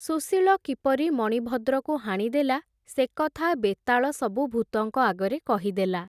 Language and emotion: Odia, neutral